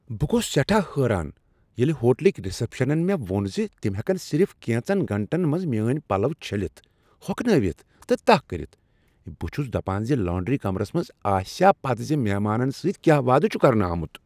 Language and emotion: Kashmiri, surprised